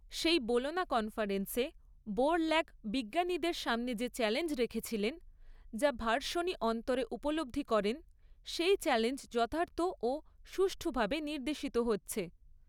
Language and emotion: Bengali, neutral